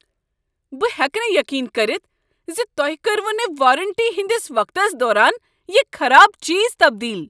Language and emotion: Kashmiri, angry